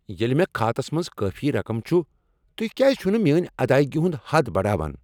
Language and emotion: Kashmiri, angry